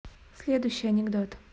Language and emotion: Russian, neutral